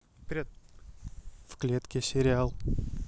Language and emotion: Russian, neutral